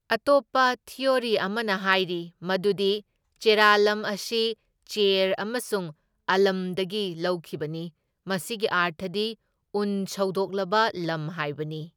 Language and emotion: Manipuri, neutral